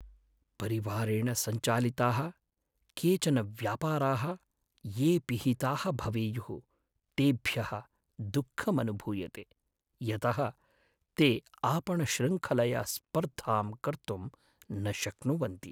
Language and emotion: Sanskrit, sad